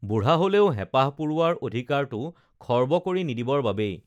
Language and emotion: Assamese, neutral